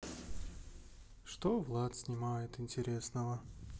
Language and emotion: Russian, sad